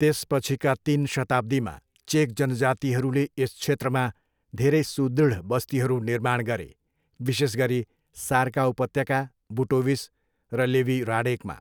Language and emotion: Nepali, neutral